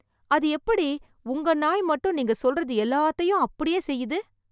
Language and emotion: Tamil, surprised